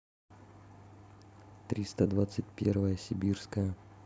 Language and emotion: Russian, neutral